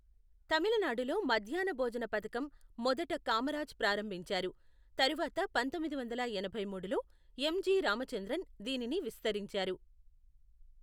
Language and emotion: Telugu, neutral